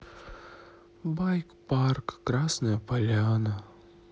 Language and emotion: Russian, sad